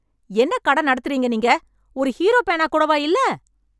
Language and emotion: Tamil, angry